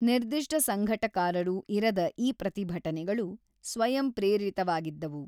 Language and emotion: Kannada, neutral